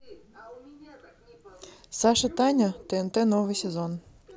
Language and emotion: Russian, neutral